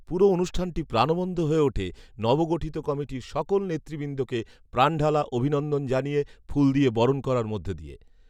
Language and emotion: Bengali, neutral